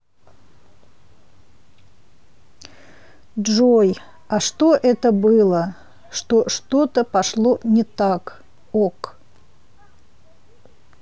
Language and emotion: Russian, neutral